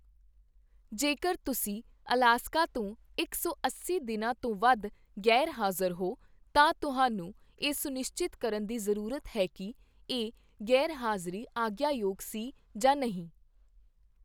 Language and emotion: Punjabi, neutral